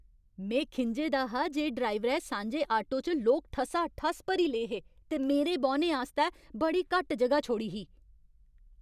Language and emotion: Dogri, angry